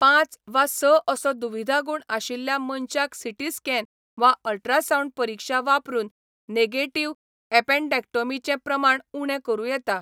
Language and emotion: Goan Konkani, neutral